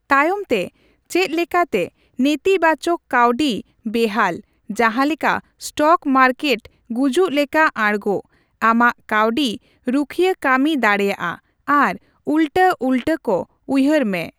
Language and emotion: Santali, neutral